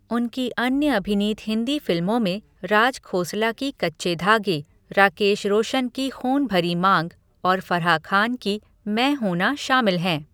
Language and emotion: Hindi, neutral